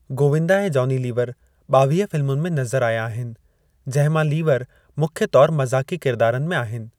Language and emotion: Sindhi, neutral